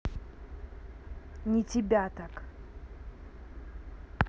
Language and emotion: Russian, angry